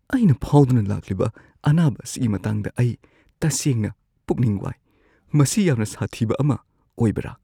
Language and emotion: Manipuri, fearful